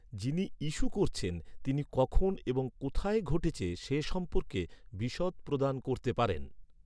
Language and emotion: Bengali, neutral